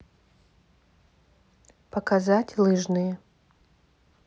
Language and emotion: Russian, neutral